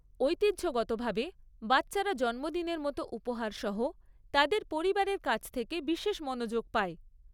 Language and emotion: Bengali, neutral